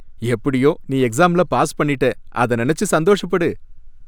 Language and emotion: Tamil, happy